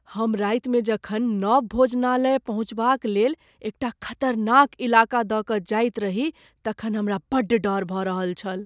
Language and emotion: Maithili, fearful